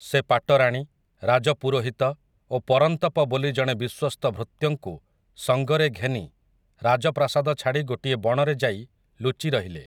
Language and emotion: Odia, neutral